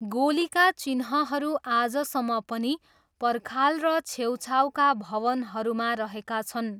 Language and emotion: Nepali, neutral